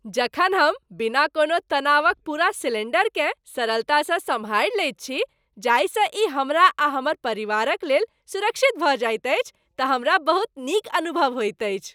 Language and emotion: Maithili, happy